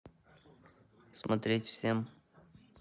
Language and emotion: Russian, neutral